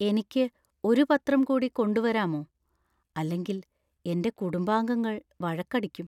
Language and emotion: Malayalam, fearful